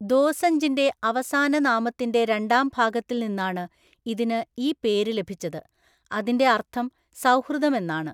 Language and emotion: Malayalam, neutral